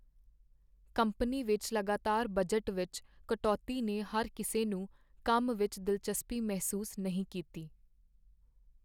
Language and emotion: Punjabi, sad